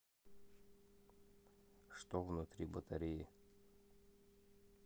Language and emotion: Russian, neutral